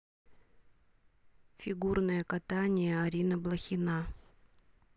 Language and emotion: Russian, neutral